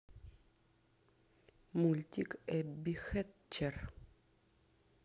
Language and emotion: Russian, neutral